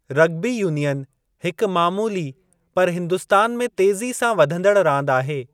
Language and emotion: Sindhi, neutral